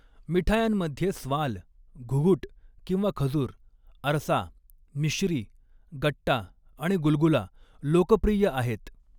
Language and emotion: Marathi, neutral